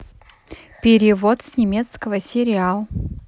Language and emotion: Russian, positive